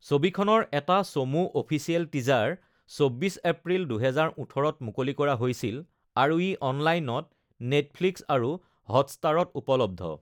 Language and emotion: Assamese, neutral